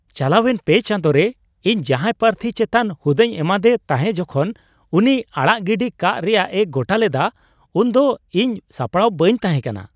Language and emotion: Santali, surprised